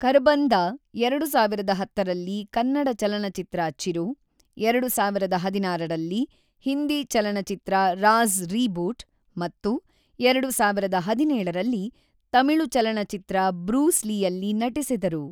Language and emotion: Kannada, neutral